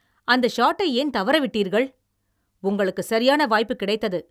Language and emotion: Tamil, angry